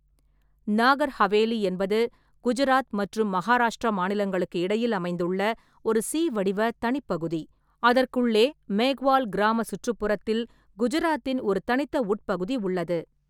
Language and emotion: Tamil, neutral